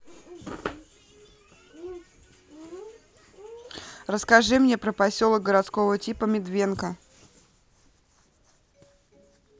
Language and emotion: Russian, neutral